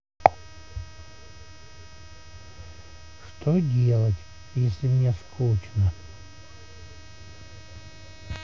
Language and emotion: Russian, sad